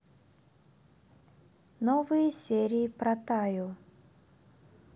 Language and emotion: Russian, neutral